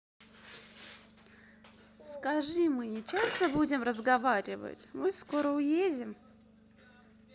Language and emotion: Russian, sad